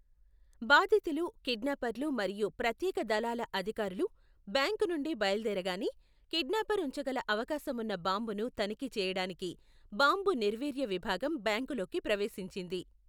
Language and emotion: Telugu, neutral